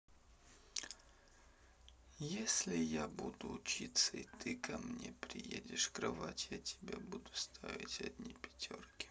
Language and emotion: Russian, neutral